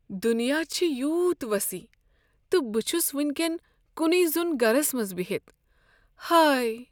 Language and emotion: Kashmiri, sad